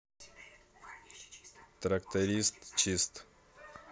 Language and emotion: Russian, neutral